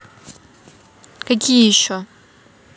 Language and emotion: Russian, neutral